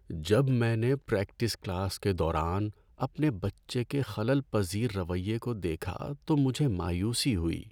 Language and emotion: Urdu, sad